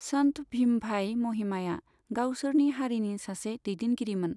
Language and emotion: Bodo, neutral